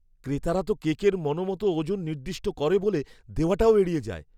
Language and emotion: Bengali, fearful